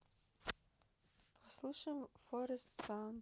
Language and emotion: Russian, neutral